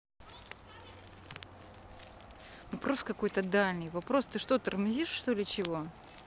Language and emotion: Russian, neutral